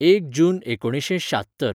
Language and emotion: Goan Konkani, neutral